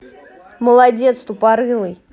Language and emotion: Russian, angry